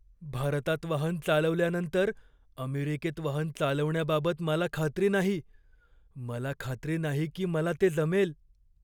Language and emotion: Marathi, fearful